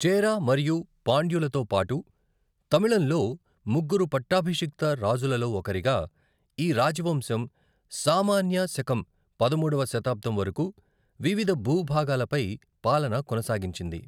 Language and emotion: Telugu, neutral